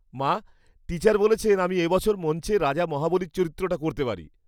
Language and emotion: Bengali, happy